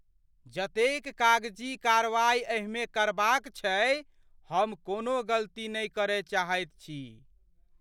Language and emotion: Maithili, fearful